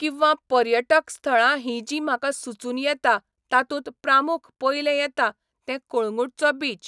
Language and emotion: Goan Konkani, neutral